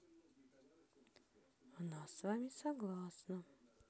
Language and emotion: Russian, neutral